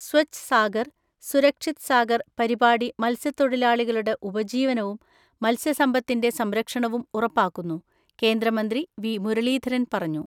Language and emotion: Malayalam, neutral